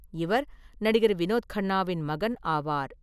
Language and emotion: Tamil, neutral